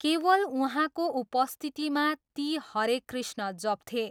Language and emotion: Nepali, neutral